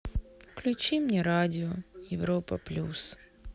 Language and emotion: Russian, sad